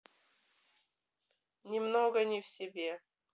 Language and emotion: Russian, neutral